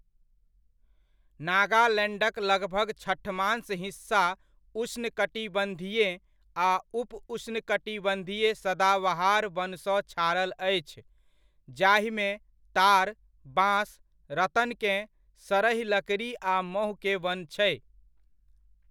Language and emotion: Maithili, neutral